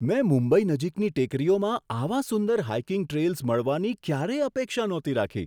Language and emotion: Gujarati, surprised